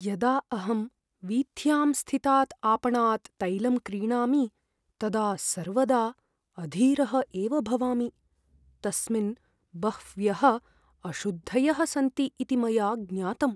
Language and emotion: Sanskrit, fearful